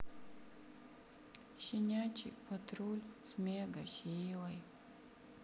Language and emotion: Russian, sad